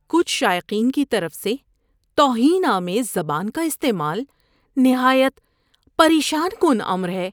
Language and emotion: Urdu, disgusted